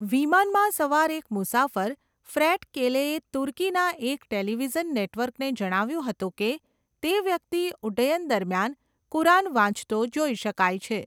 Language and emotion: Gujarati, neutral